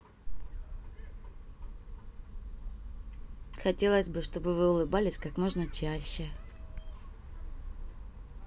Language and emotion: Russian, positive